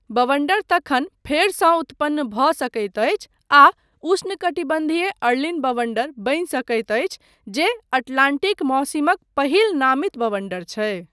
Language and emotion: Maithili, neutral